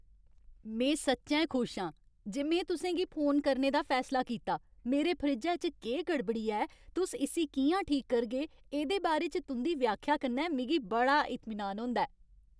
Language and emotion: Dogri, happy